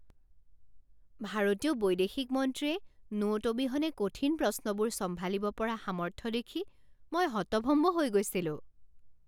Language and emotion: Assamese, surprised